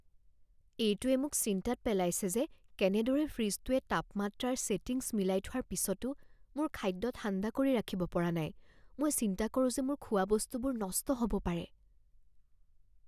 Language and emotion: Assamese, fearful